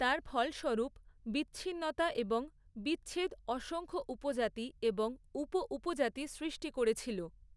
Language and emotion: Bengali, neutral